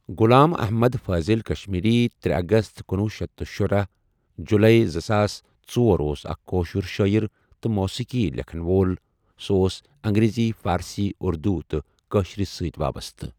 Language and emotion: Kashmiri, neutral